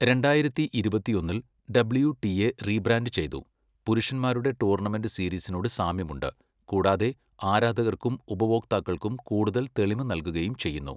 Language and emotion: Malayalam, neutral